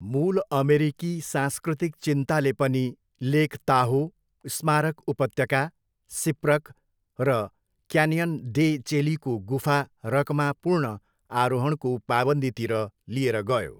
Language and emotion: Nepali, neutral